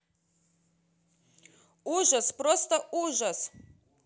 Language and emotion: Russian, angry